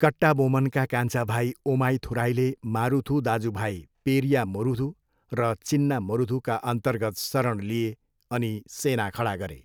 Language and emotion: Nepali, neutral